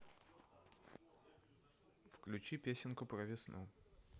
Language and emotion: Russian, neutral